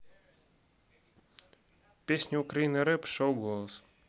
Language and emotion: Russian, neutral